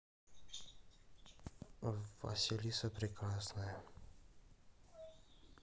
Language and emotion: Russian, neutral